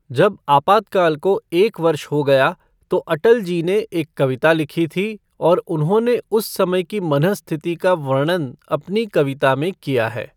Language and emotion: Hindi, neutral